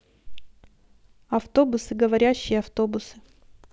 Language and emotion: Russian, neutral